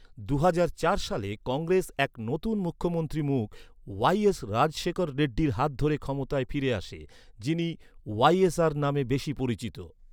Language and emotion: Bengali, neutral